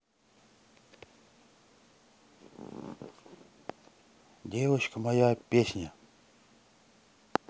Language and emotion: Russian, neutral